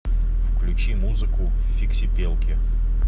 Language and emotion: Russian, neutral